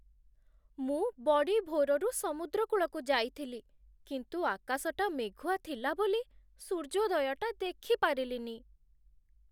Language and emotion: Odia, sad